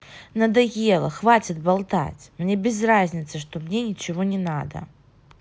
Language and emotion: Russian, angry